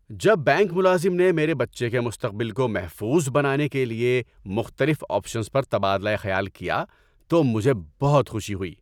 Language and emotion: Urdu, happy